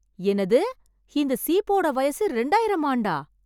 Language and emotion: Tamil, surprised